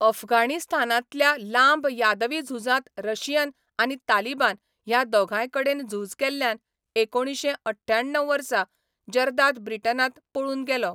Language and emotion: Goan Konkani, neutral